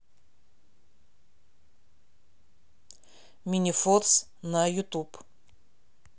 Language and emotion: Russian, neutral